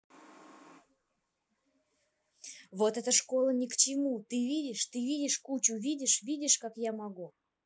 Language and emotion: Russian, neutral